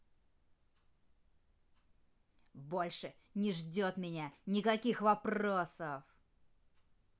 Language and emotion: Russian, angry